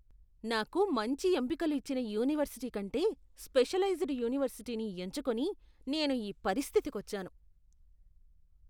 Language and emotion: Telugu, disgusted